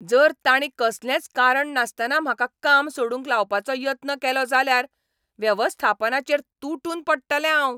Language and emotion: Goan Konkani, angry